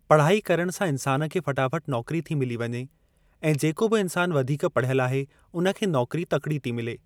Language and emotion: Sindhi, neutral